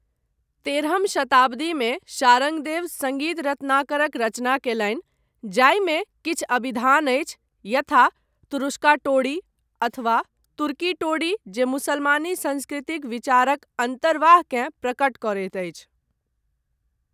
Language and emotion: Maithili, neutral